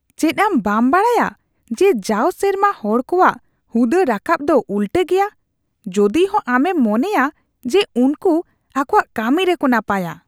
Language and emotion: Santali, disgusted